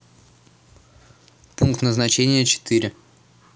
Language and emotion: Russian, neutral